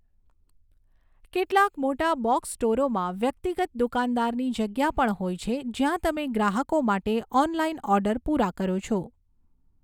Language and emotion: Gujarati, neutral